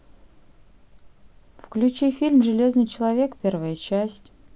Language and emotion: Russian, neutral